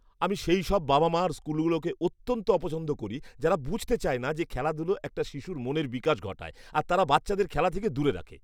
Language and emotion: Bengali, disgusted